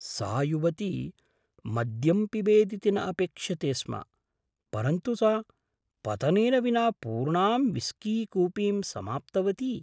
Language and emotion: Sanskrit, surprised